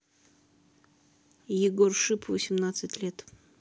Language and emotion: Russian, neutral